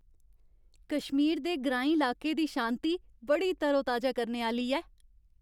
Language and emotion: Dogri, happy